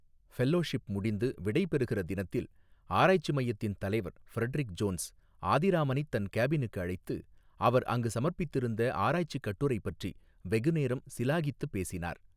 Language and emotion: Tamil, neutral